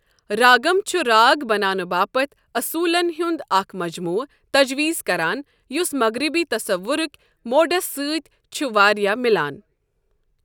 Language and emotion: Kashmiri, neutral